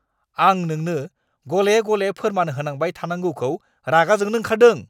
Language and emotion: Bodo, angry